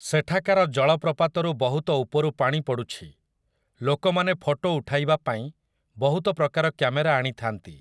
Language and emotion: Odia, neutral